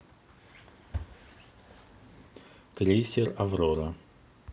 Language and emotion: Russian, neutral